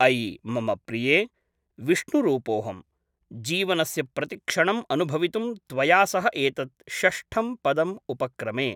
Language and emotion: Sanskrit, neutral